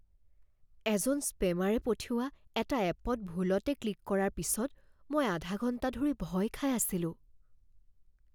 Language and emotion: Assamese, fearful